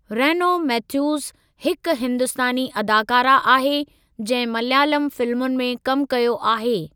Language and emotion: Sindhi, neutral